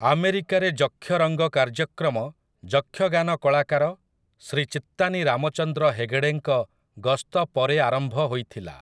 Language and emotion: Odia, neutral